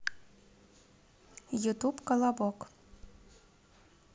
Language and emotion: Russian, neutral